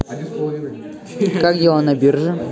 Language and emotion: Russian, neutral